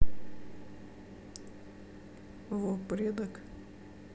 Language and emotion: Russian, sad